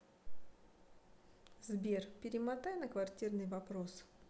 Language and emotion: Russian, neutral